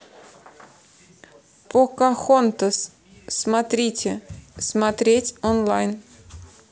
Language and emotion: Russian, neutral